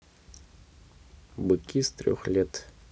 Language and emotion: Russian, neutral